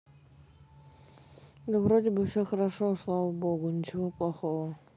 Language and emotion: Russian, neutral